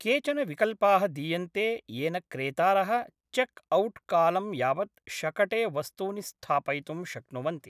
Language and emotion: Sanskrit, neutral